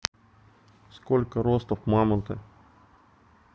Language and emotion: Russian, neutral